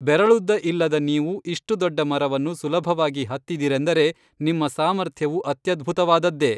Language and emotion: Kannada, neutral